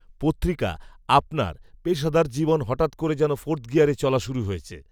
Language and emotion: Bengali, neutral